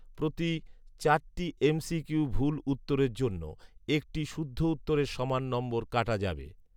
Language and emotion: Bengali, neutral